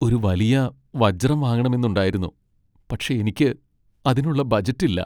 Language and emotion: Malayalam, sad